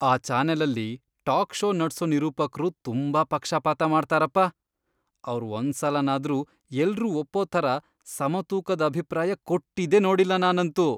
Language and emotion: Kannada, disgusted